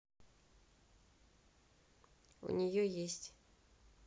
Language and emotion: Russian, neutral